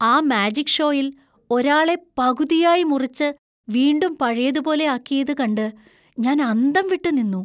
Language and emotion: Malayalam, surprised